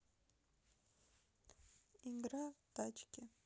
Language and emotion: Russian, sad